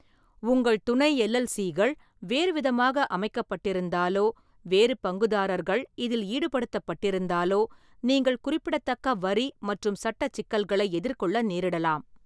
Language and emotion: Tamil, neutral